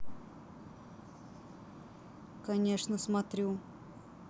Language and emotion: Russian, neutral